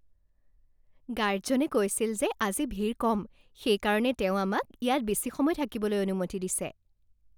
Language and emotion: Assamese, happy